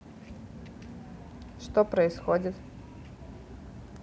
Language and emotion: Russian, neutral